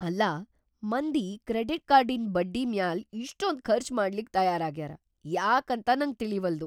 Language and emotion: Kannada, surprised